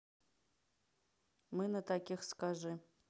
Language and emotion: Russian, neutral